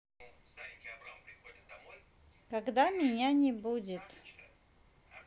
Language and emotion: Russian, neutral